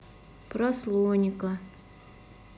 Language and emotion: Russian, sad